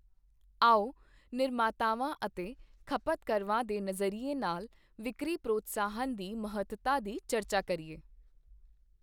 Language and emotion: Punjabi, neutral